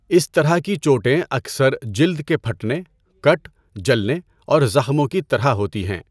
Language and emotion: Urdu, neutral